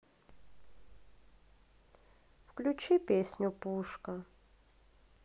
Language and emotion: Russian, sad